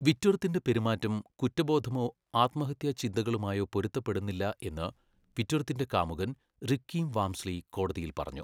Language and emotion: Malayalam, neutral